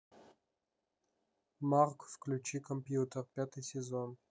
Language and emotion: Russian, neutral